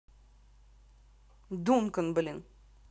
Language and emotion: Russian, angry